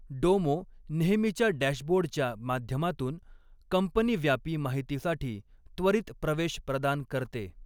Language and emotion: Marathi, neutral